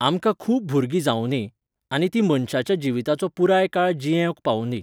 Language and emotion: Goan Konkani, neutral